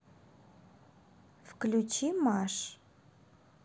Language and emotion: Russian, neutral